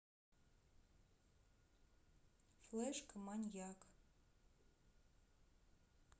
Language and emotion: Russian, neutral